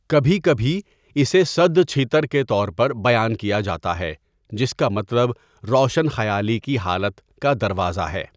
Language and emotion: Urdu, neutral